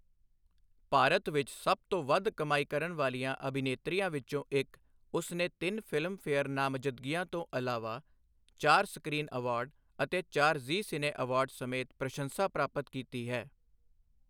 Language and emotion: Punjabi, neutral